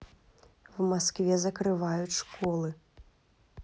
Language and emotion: Russian, neutral